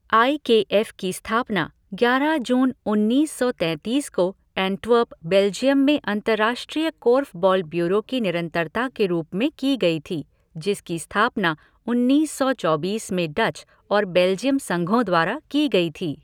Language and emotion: Hindi, neutral